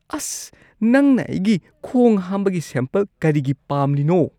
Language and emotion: Manipuri, disgusted